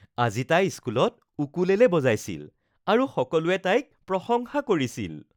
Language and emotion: Assamese, happy